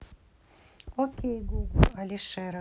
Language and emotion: Russian, neutral